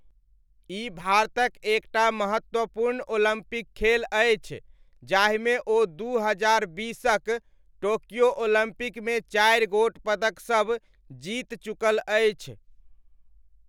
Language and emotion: Maithili, neutral